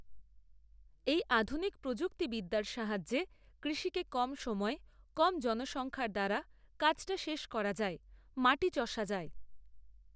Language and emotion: Bengali, neutral